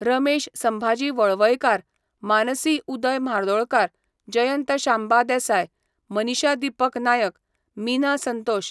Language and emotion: Goan Konkani, neutral